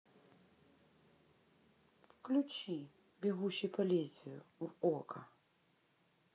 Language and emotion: Russian, neutral